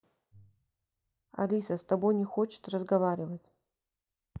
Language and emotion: Russian, neutral